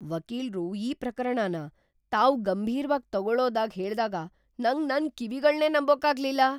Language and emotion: Kannada, surprised